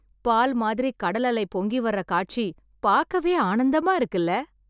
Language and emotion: Tamil, happy